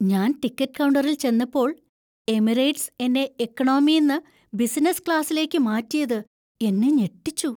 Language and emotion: Malayalam, surprised